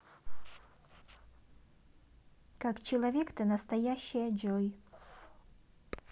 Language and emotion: Russian, positive